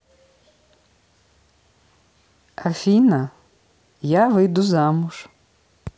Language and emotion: Russian, neutral